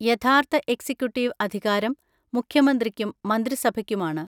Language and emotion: Malayalam, neutral